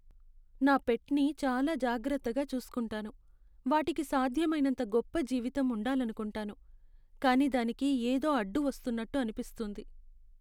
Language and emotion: Telugu, sad